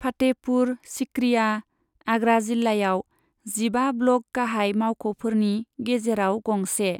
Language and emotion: Bodo, neutral